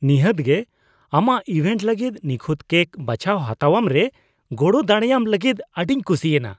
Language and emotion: Santali, disgusted